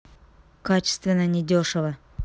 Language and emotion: Russian, angry